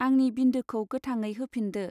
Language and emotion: Bodo, neutral